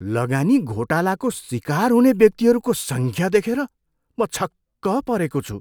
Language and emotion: Nepali, surprised